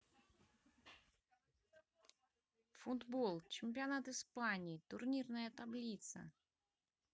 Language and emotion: Russian, positive